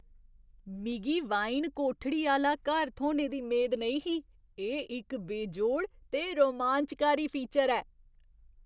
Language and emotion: Dogri, surprised